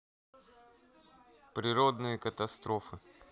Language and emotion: Russian, neutral